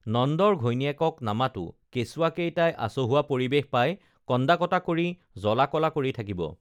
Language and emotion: Assamese, neutral